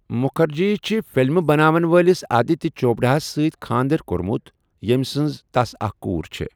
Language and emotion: Kashmiri, neutral